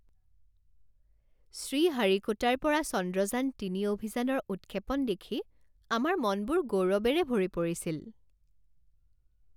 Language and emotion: Assamese, happy